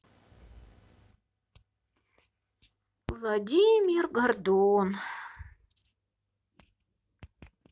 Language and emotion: Russian, sad